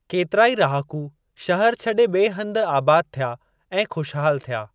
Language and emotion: Sindhi, neutral